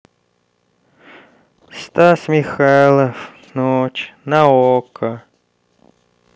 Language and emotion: Russian, sad